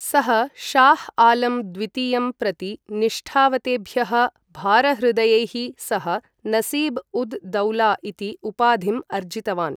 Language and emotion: Sanskrit, neutral